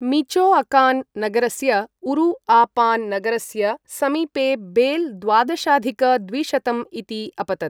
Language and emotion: Sanskrit, neutral